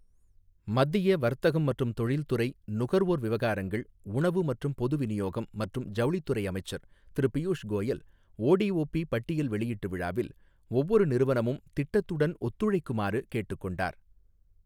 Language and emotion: Tamil, neutral